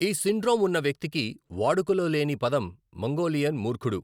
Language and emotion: Telugu, neutral